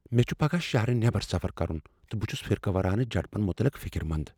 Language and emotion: Kashmiri, fearful